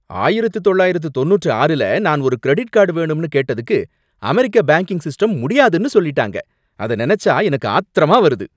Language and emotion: Tamil, angry